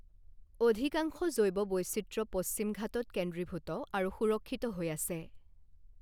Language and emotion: Assamese, neutral